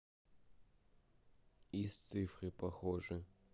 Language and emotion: Russian, neutral